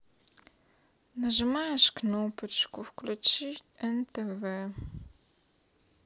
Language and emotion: Russian, sad